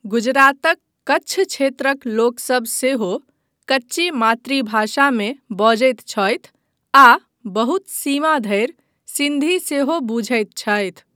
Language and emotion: Maithili, neutral